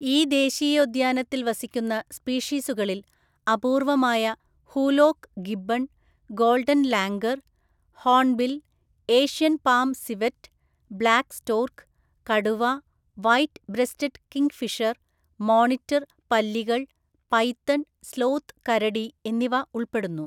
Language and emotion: Malayalam, neutral